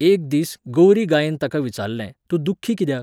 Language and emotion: Goan Konkani, neutral